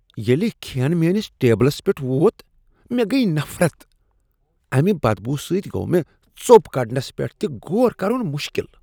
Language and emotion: Kashmiri, disgusted